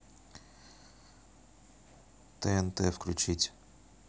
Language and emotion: Russian, neutral